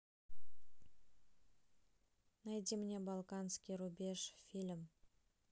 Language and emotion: Russian, neutral